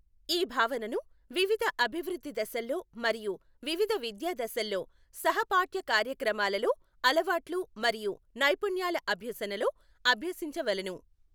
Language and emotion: Telugu, neutral